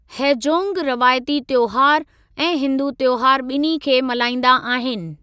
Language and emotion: Sindhi, neutral